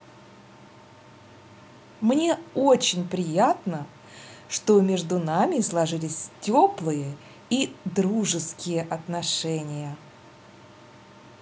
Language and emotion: Russian, positive